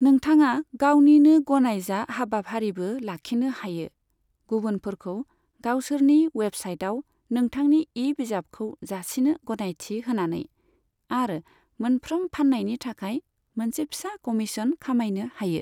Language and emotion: Bodo, neutral